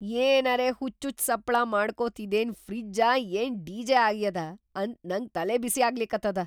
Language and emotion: Kannada, surprised